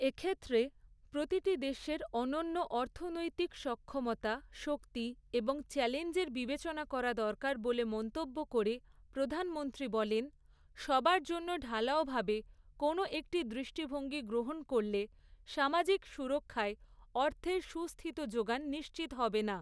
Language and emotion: Bengali, neutral